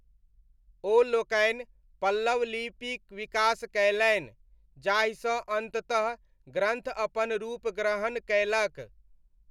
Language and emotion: Maithili, neutral